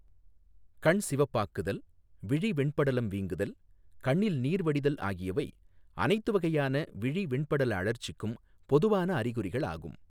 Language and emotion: Tamil, neutral